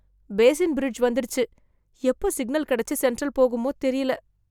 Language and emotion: Tamil, fearful